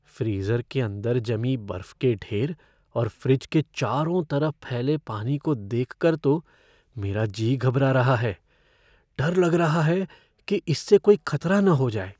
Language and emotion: Hindi, fearful